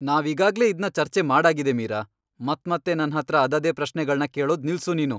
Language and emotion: Kannada, angry